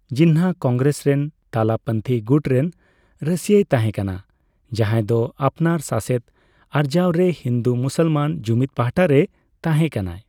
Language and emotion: Santali, neutral